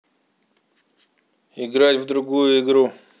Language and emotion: Russian, angry